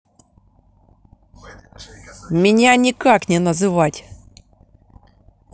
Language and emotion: Russian, angry